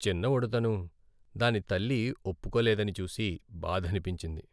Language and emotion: Telugu, sad